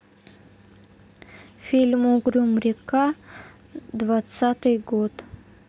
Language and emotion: Russian, neutral